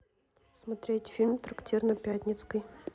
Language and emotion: Russian, neutral